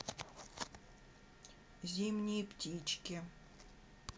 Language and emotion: Russian, neutral